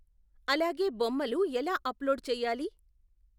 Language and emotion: Telugu, neutral